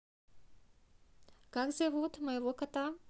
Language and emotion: Russian, neutral